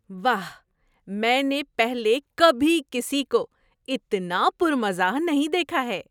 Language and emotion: Urdu, surprised